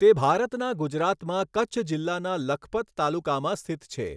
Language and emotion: Gujarati, neutral